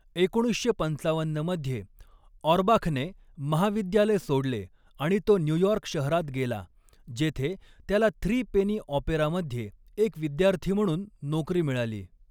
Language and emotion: Marathi, neutral